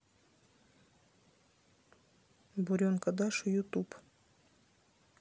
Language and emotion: Russian, neutral